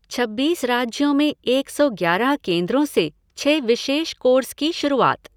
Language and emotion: Hindi, neutral